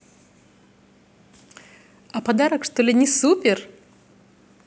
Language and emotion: Russian, positive